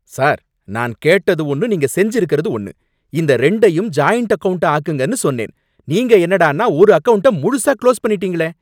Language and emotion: Tamil, angry